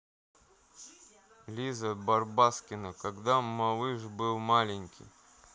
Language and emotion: Russian, neutral